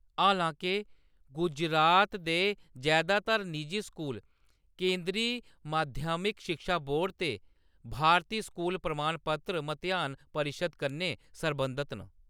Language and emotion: Dogri, neutral